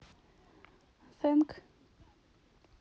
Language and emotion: Russian, neutral